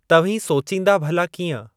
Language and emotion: Sindhi, neutral